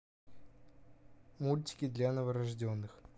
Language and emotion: Russian, neutral